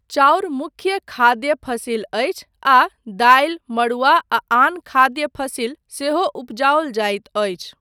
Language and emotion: Maithili, neutral